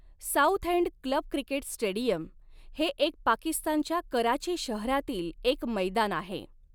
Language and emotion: Marathi, neutral